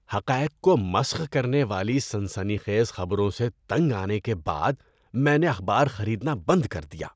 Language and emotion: Urdu, disgusted